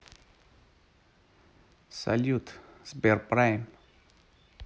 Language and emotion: Russian, positive